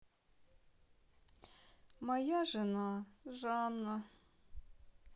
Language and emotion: Russian, sad